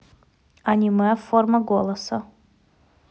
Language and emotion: Russian, neutral